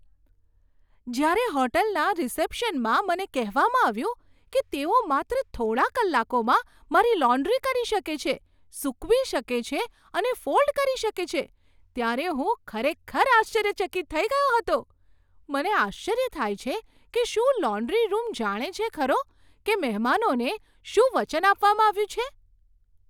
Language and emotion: Gujarati, surprised